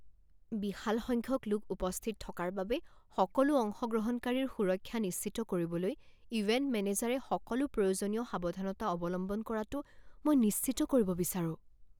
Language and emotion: Assamese, fearful